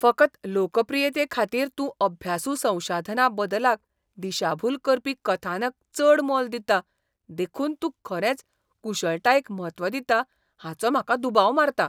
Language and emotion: Goan Konkani, disgusted